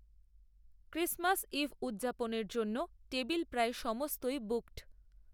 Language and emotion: Bengali, neutral